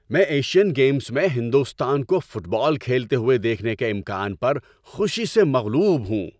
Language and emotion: Urdu, happy